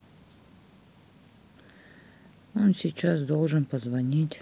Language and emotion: Russian, sad